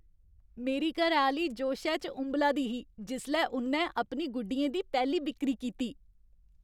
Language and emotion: Dogri, happy